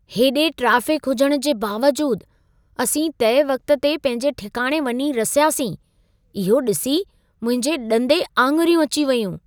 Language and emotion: Sindhi, surprised